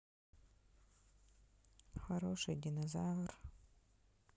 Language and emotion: Russian, sad